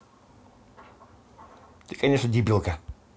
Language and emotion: Russian, neutral